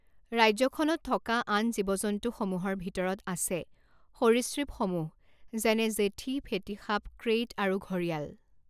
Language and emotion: Assamese, neutral